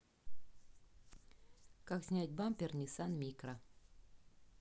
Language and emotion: Russian, neutral